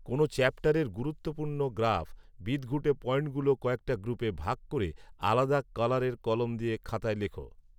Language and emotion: Bengali, neutral